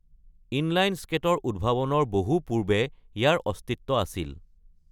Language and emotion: Assamese, neutral